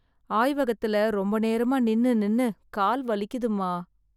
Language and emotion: Tamil, sad